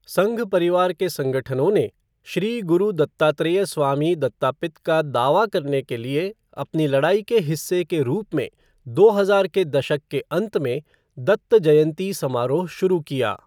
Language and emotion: Hindi, neutral